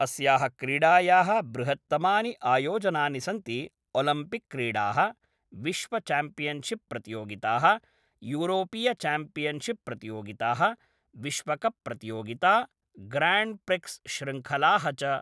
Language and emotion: Sanskrit, neutral